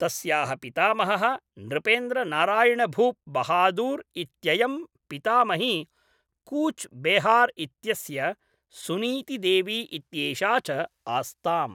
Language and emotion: Sanskrit, neutral